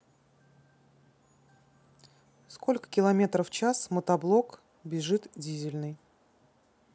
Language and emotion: Russian, neutral